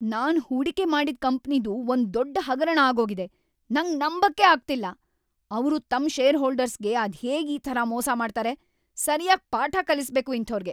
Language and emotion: Kannada, angry